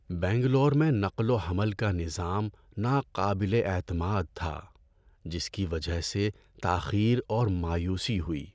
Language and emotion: Urdu, sad